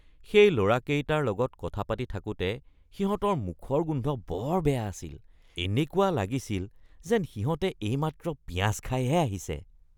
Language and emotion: Assamese, disgusted